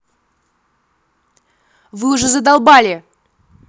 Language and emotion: Russian, angry